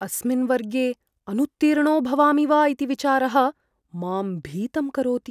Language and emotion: Sanskrit, fearful